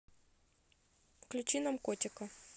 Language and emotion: Russian, neutral